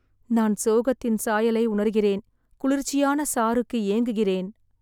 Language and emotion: Tamil, sad